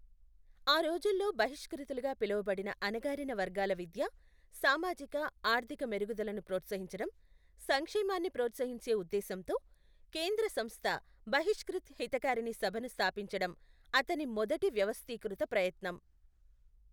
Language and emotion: Telugu, neutral